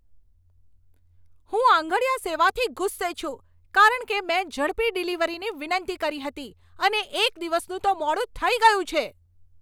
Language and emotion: Gujarati, angry